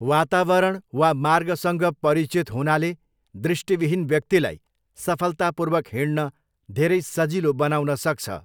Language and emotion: Nepali, neutral